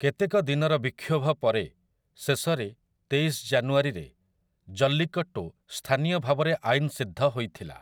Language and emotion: Odia, neutral